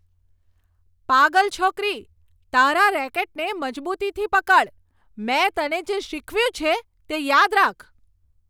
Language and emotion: Gujarati, angry